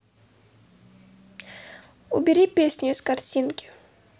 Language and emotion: Russian, neutral